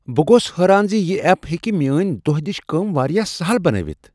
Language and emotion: Kashmiri, surprised